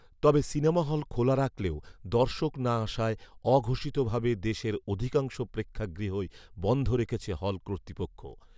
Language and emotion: Bengali, neutral